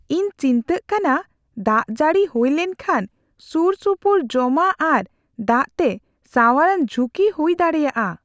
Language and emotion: Santali, fearful